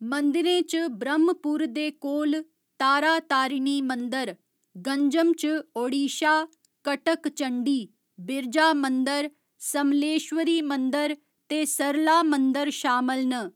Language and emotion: Dogri, neutral